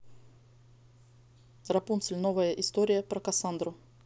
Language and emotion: Russian, neutral